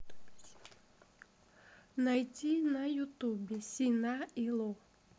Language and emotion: Russian, neutral